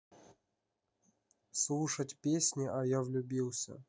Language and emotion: Russian, neutral